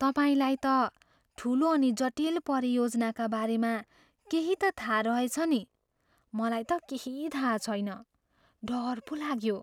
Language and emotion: Nepali, fearful